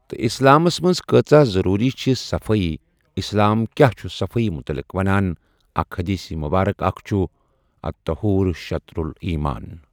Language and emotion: Kashmiri, neutral